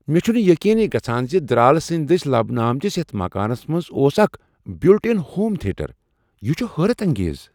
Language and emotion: Kashmiri, surprised